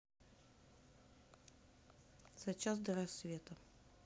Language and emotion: Russian, neutral